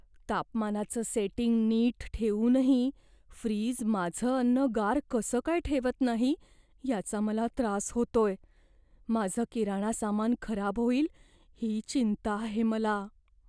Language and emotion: Marathi, fearful